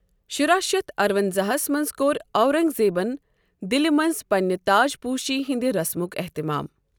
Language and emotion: Kashmiri, neutral